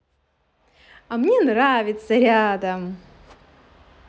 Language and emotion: Russian, positive